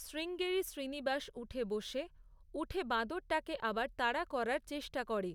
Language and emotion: Bengali, neutral